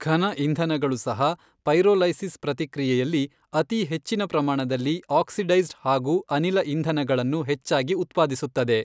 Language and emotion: Kannada, neutral